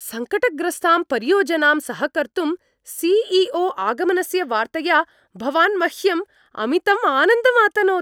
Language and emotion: Sanskrit, happy